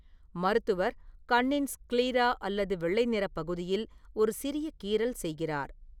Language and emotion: Tamil, neutral